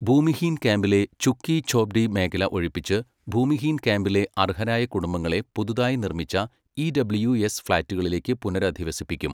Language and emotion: Malayalam, neutral